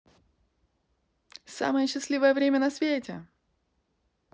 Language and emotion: Russian, positive